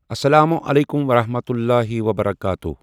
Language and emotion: Kashmiri, neutral